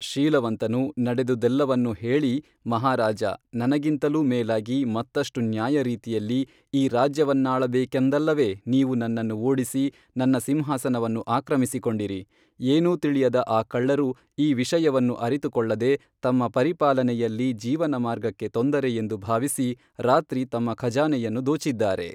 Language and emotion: Kannada, neutral